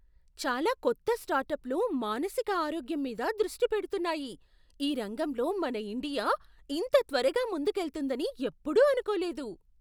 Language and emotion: Telugu, surprised